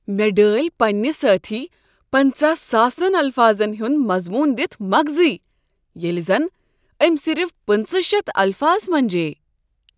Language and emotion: Kashmiri, surprised